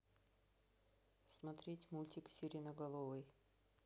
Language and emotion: Russian, neutral